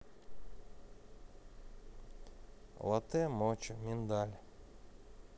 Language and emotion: Russian, neutral